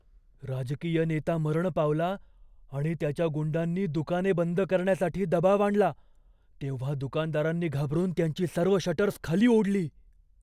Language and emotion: Marathi, fearful